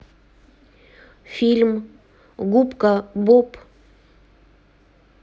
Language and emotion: Russian, neutral